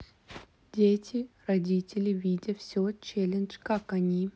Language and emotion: Russian, neutral